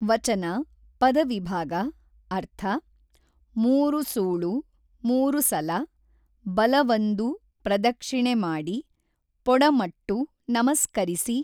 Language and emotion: Kannada, neutral